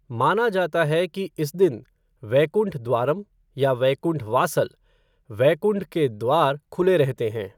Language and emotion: Hindi, neutral